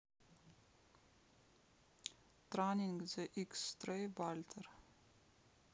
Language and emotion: Russian, neutral